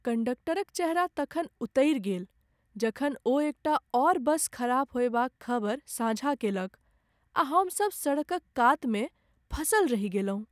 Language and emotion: Maithili, sad